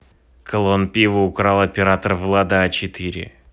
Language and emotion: Russian, neutral